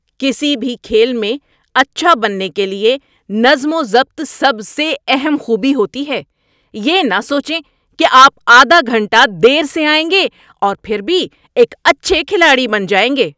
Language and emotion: Urdu, angry